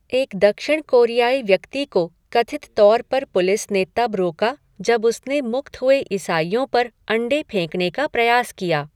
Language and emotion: Hindi, neutral